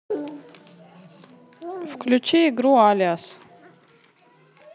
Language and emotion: Russian, neutral